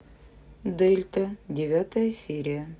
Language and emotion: Russian, neutral